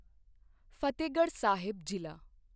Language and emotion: Punjabi, neutral